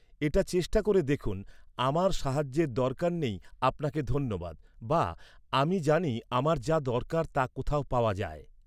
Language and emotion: Bengali, neutral